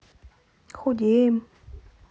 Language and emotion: Russian, neutral